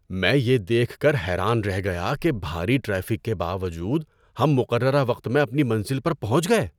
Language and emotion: Urdu, surprised